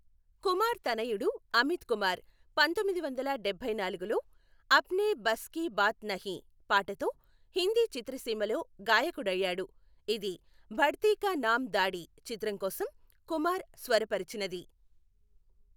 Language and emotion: Telugu, neutral